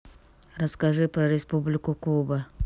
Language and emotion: Russian, neutral